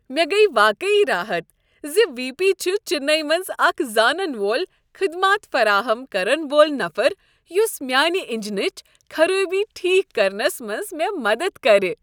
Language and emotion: Kashmiri, happy